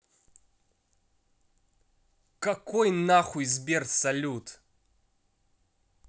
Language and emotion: Russian, angry